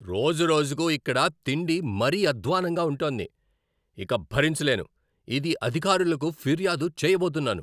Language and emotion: Telugu, angry